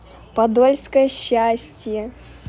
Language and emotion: Russian, positive